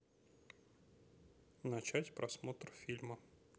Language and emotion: Russian, neutral